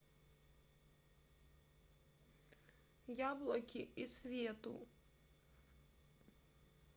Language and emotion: Russian, sad